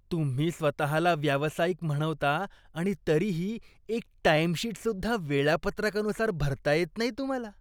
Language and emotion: Marathi, disgusted